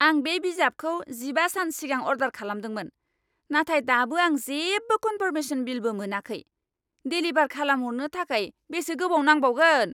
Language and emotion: Bodo, angry